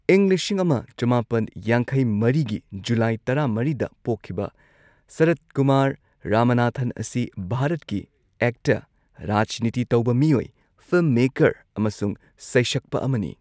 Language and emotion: Manipuri, neutral